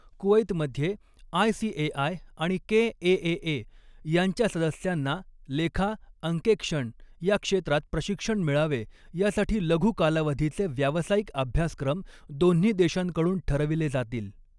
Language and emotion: Marathi, neutral